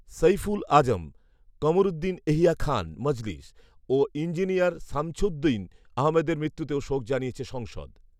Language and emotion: Bengali, neutral